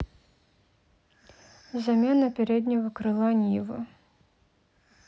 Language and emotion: Russian, neutral